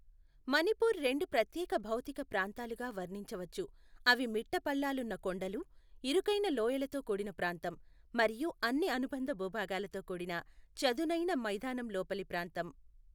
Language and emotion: Telugu, neutral